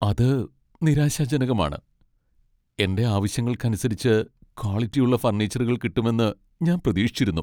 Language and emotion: Malayalam, sad